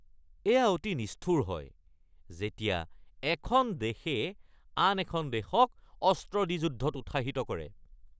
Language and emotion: Assamese, angry